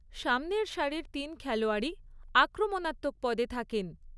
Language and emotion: Bengali, neutral